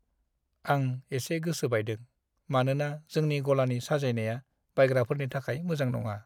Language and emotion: Bodo, sad